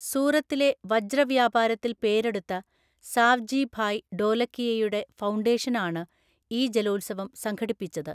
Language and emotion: Malayalam, neutral